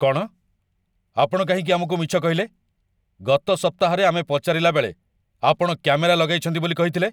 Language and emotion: Odia, angry